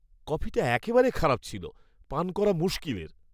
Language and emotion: Bengali, disgusted